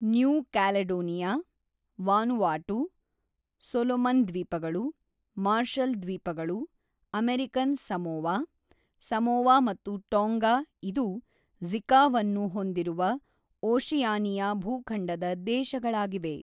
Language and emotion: Kannada, neutral